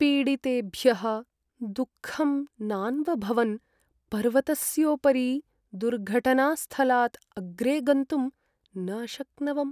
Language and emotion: Sanskrit, sad